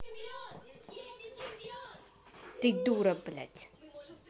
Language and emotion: Russian, angry